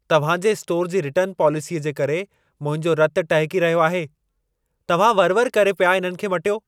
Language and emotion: Sindhi, angry